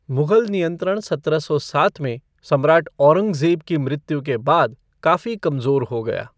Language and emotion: Hindi, neutral